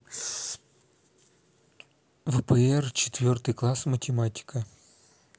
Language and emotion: Russian, neutral